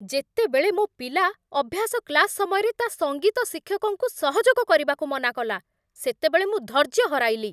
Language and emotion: Odia, angry